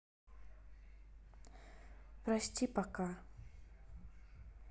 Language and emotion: Russian, sad